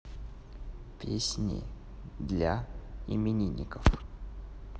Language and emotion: Russian, neutral